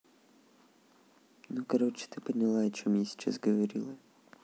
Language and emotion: Russian, sad